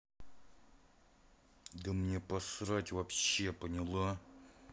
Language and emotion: Russian, angry